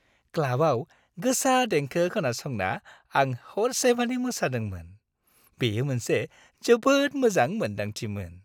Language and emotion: Bodo, happy